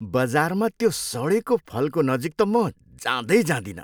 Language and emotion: Nepali, disgusted